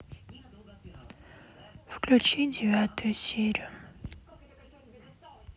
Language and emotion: Russian, sad